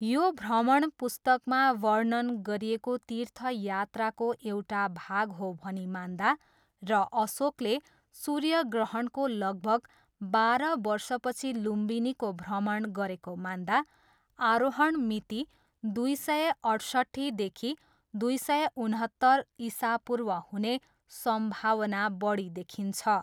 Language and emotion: Nepali, neutral